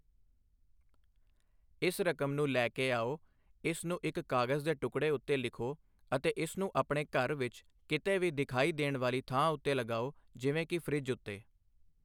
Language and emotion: Punjabi, neutral